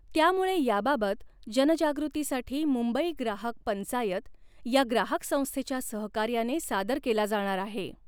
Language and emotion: Marathi, neutral